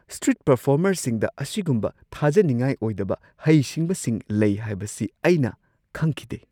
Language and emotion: Manipuri, surprised